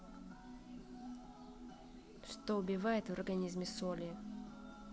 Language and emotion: Russian, neutral